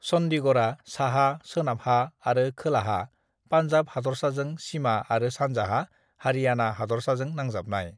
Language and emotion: Bodo, neutral